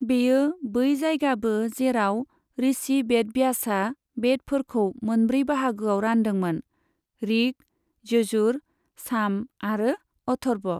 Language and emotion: Bodo, neutral